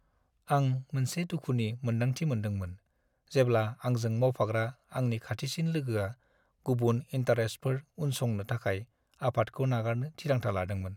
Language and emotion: Bodo, sad